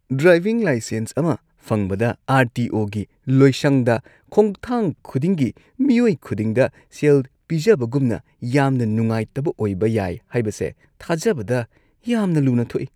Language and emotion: Manipuri, disgusted